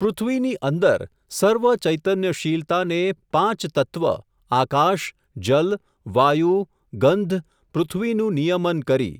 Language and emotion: Gujarati, neutral